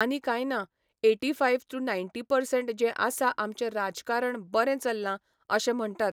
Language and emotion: Goan Konkani, neutral